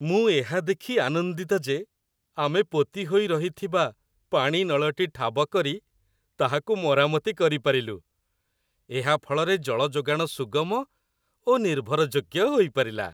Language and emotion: Odia, happy